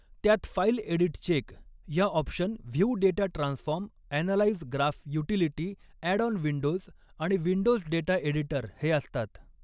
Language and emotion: Marathi, neutral